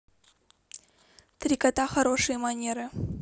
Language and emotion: Russian, neutral